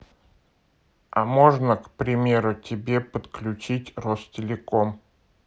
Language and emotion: Russian, neutral